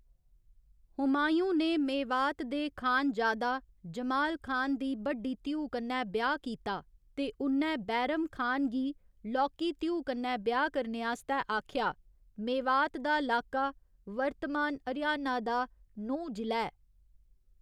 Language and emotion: Dogri, neutral